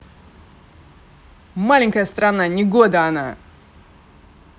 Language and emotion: Russian, positive